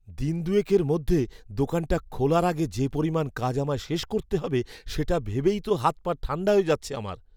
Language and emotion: Bengali, fearful